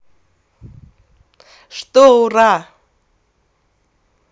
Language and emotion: Russian, positive